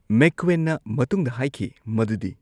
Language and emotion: Manipuri, neutral